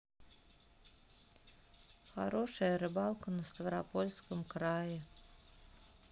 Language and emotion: Russian, sad